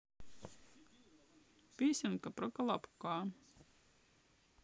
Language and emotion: Russian, sad